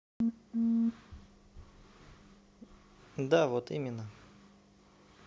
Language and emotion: Russian, neutral